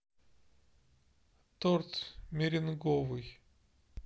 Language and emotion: Russian, neutral